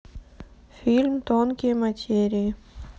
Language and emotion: Russian, neutral